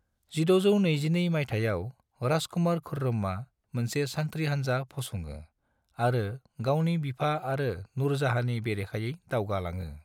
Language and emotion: Bodo, neutral